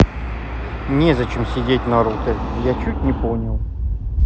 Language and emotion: Russian, neutral